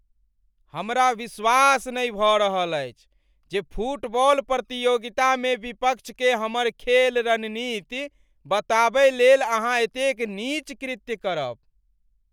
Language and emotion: Maithili, angry